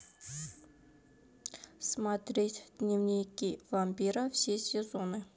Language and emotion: Russian, neutral